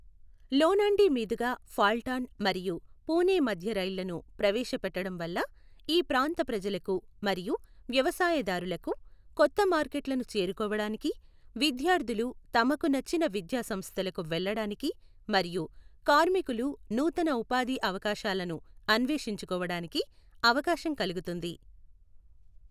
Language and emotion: Telugu, neutral